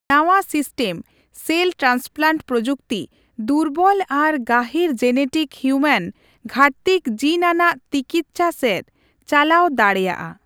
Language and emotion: Santali, neutral